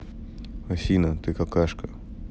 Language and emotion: Russian, neutral